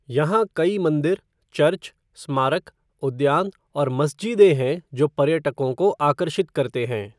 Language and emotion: Hindi, neutral